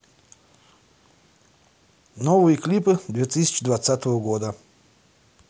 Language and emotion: Russian, neutral